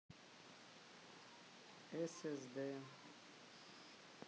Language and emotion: Russian, neutral